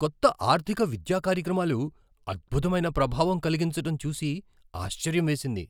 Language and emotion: Telugu, surprised